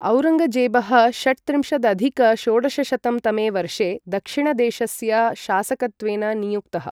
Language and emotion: Sanskrit, neutral